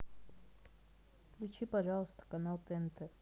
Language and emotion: Russian, neutral